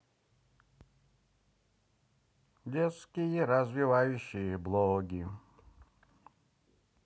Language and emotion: Russian, positive